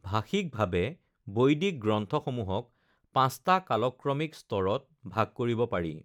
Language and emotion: Assamese, neutral